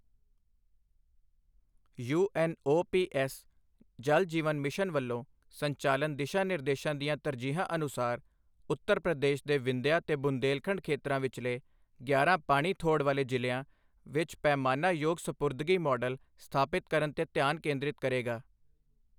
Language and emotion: Punjabi, neutral